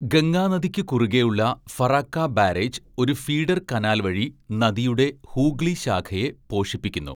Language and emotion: Malayalam, neutral